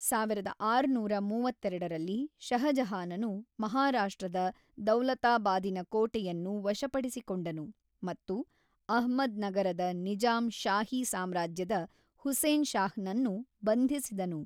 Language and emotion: Kannada, neutral